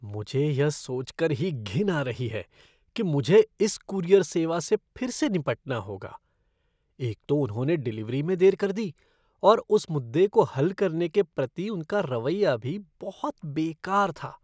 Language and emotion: Hindi, disgusted